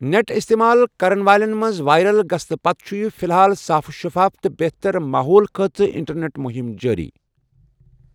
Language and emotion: Kashmiri, neutral